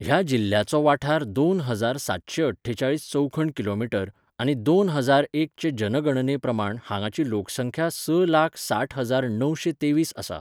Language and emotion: Goan Konkani, neutral